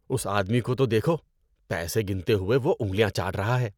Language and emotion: Urdu, disgusted